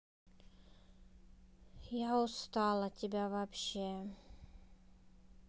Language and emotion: Russian, sad